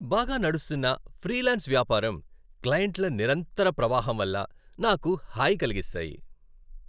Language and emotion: Telugu, happy